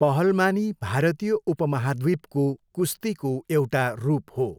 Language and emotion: Nepali, neutral